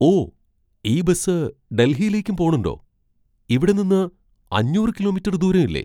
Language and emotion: Malayalam, surprised